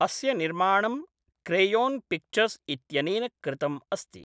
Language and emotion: Sanskrit, neutral